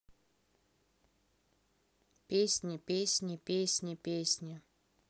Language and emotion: Russian, neutral